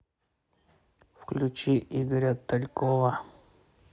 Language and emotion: Russian, neutral